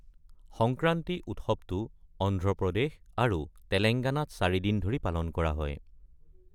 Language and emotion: Assamese, neutral